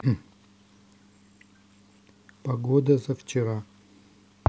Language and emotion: Russian, neutral